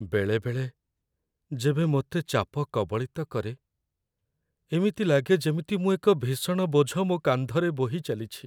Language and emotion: Odia, sad